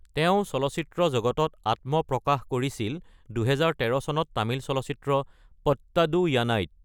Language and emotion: Assamese, neutral